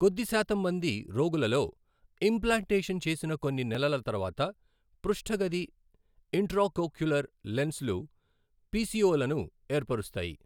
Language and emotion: Telugu, neutral